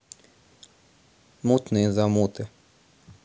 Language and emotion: Russian, neutral